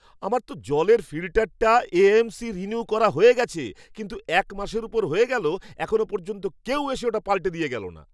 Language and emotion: Bengali, angry